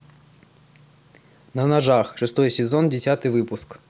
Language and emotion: Russian, neutral